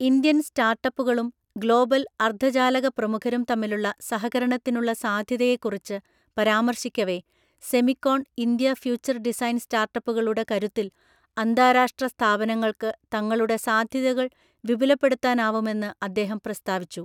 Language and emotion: Malayalam, neutral